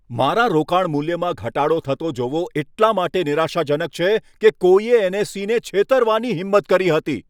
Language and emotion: Gujarati, angry